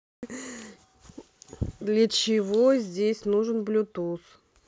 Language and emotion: Russian, neutral